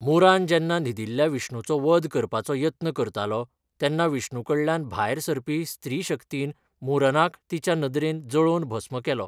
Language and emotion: Goan Konkani, neutral